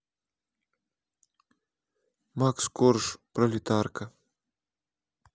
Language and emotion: Russian, neutral